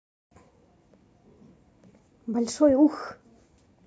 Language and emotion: Russian, neutral